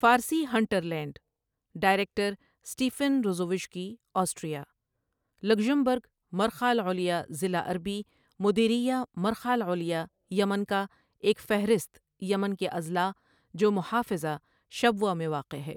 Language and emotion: Urdu, neutral